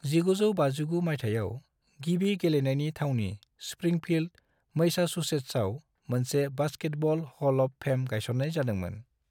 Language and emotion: Bodo, neutral